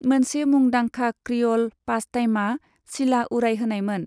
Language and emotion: Bodo, neutral